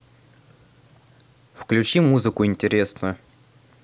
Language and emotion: Russian, neutral